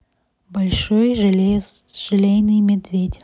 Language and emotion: Russian, neutral